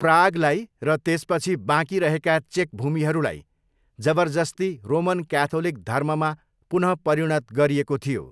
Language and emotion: Nepali, neutral